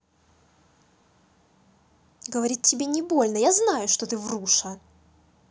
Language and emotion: Russian, angry